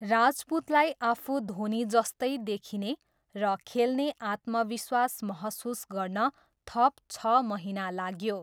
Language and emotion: Nepali, neutral